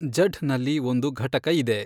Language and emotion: Kannada, neutral